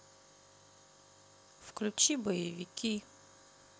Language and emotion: Russian, neutral